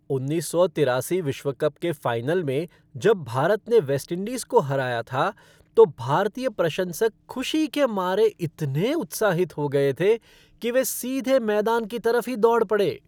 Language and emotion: Hindi, happy